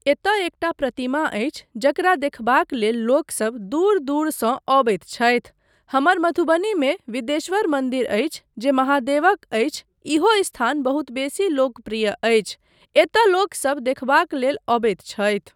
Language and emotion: Maithili, neutral